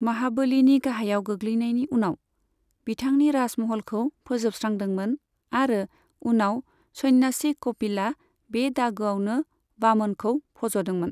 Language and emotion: Bodo, neutral